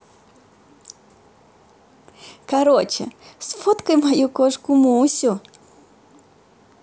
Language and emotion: Russian, positive